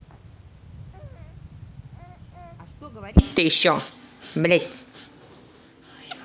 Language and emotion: Russian, angry